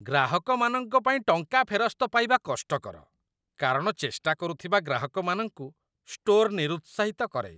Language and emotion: Odia, disgusted